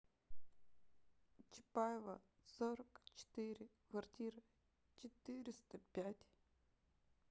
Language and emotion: Russian, sad